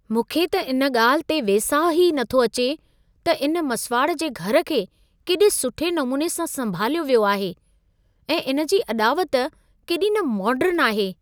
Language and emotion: Sindhi, surprised